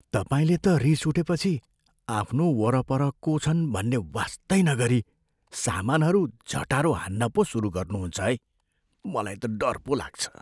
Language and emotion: Nepali, fearful